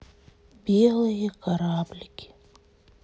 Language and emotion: Russian, sad